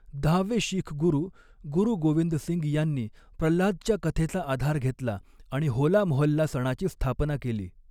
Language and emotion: Marathi, neutral